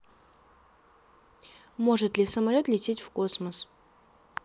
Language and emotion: Russian, neutral